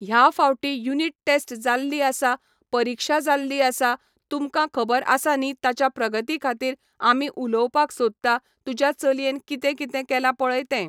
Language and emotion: Goan Konkani, neutral